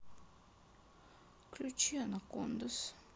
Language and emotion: Russian, sad